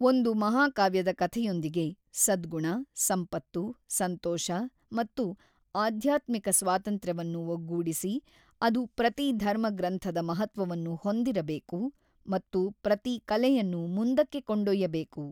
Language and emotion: Kannada, neutral